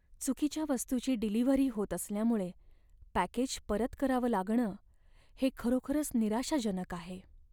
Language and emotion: Marathi, sad